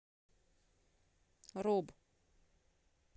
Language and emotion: Russian, neutral